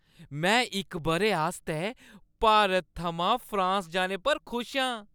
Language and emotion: Dogri, happy